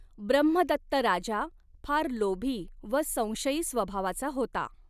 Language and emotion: Marathi, neutral